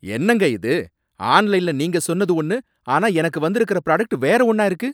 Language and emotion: Tamil, angry